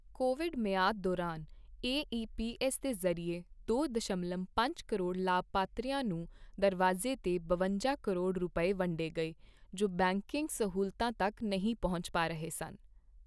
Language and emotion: Punjabi, neutral